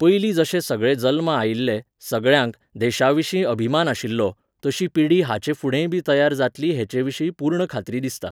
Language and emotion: Goan Konkani, neutral